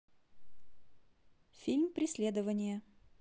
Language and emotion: Russian, neutral